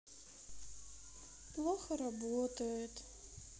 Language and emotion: Russian, sad